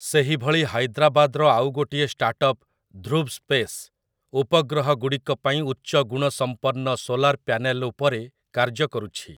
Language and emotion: Odia, neutral